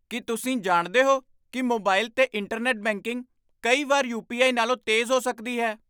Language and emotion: Punjabi, surprised